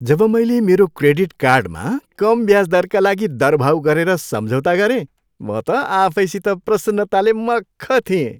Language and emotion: Nepali, happy